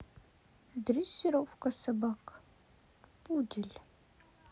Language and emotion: Russian, neutral